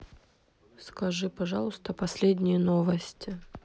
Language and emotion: Russian, neutral